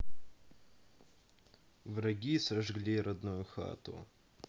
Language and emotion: Russian, sad